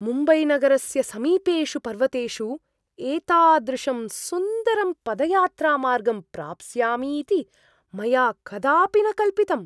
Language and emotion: Sanskrit, surprised